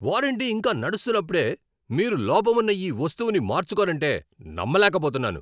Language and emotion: Telugu, angry